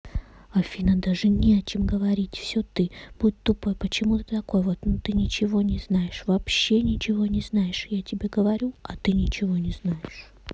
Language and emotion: Russian, neutral